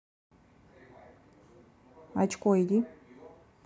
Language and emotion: Russian, angry